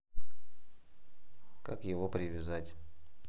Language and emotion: Russian, neutral